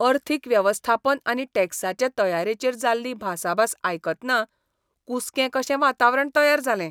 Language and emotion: Goan Konkani, disgusted